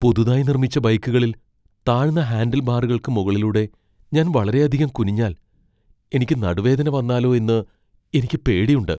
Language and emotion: Malayalam, fearful